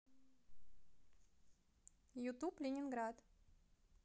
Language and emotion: Russian, positive